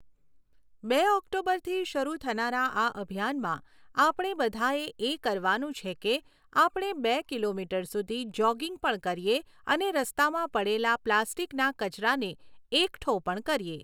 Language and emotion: Gujarati, neutral